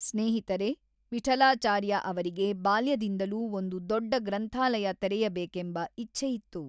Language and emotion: Kannada, neutral